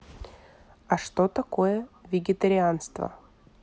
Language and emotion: Russian, neutral